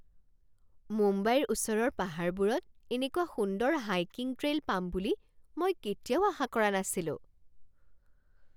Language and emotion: Assamese, surprised